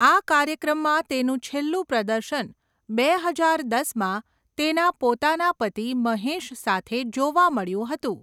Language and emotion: Gujarati, neutral